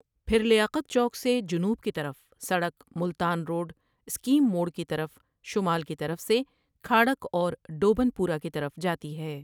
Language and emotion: Urdu, neutral